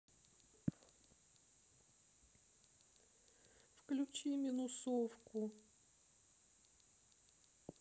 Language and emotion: Russian, sad